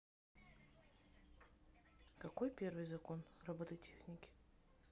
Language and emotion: Russian, neutral